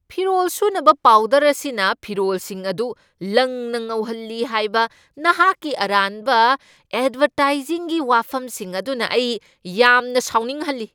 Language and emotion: Manipuri, angry